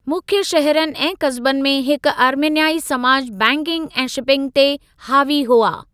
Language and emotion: Sindhi, neutral